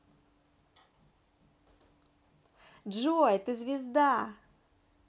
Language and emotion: Russian, positive